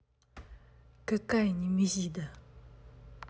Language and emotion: Russian, angry